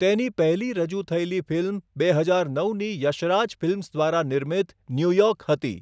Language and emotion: Gujarati, neutral